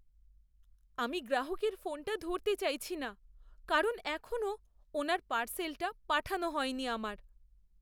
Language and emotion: Bengali, fearful